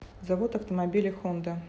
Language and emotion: Russian, neutral